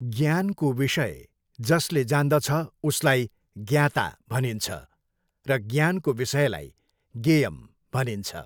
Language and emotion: Nepali, neutral